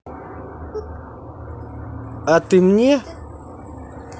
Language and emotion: Russian, neutral